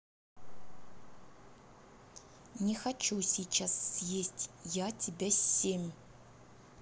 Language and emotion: Russian, angry